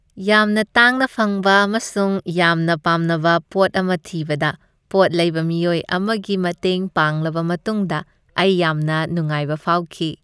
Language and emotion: Manipuri, happy